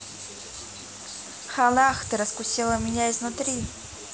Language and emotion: Russian, positive